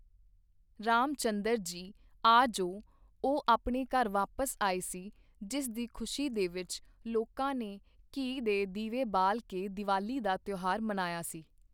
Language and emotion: Punjabi, neutral